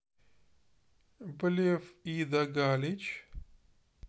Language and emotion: Russian, neutral